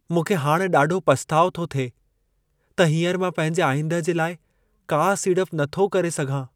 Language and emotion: Sindhi, sad